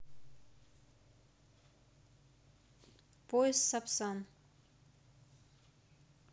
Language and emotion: Russian, neutral